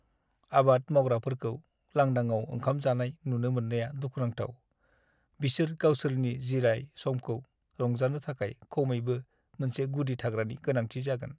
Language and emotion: Bodo, sad